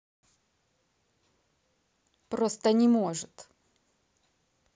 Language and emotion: Russian, angry